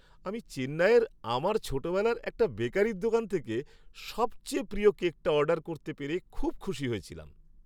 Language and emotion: Bengali, happy